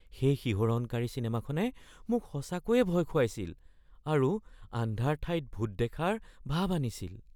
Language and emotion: Assamese, fearful